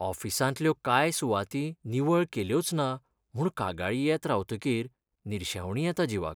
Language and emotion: Goan Konkani, sad